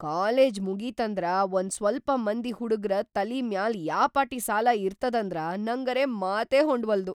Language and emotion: Kannada, surprised